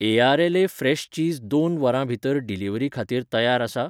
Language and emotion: Goan Konkani, neutral